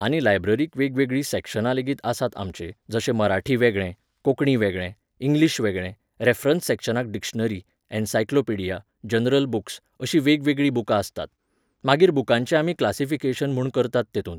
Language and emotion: Goan Konkani, neutral